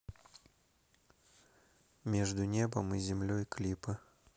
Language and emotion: Russian, neutral